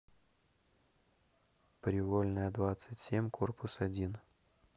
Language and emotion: Russian, neutral